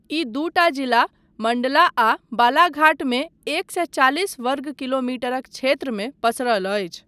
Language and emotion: Maithili, neutral